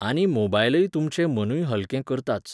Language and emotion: Goan Konkani, neutral